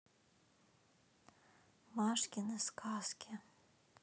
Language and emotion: Russian, neutral